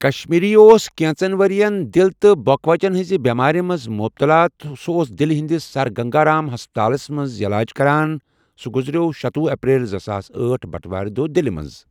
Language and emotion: Kashmiri, neutral